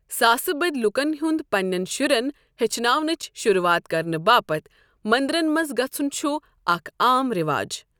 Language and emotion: Kashmiri, neutral